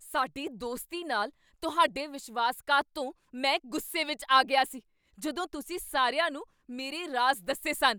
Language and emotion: Punjabi, angry